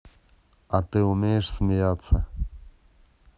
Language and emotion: Russian, neutral